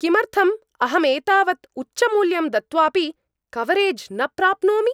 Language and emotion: Sanskrit, angry